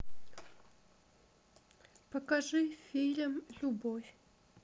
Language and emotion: Russian, sad